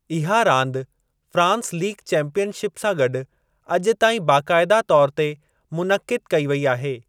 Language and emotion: Sindhi, neutral